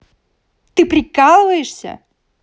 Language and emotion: Russian, angry